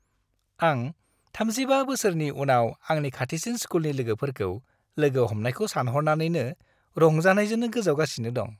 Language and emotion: Bodo, happy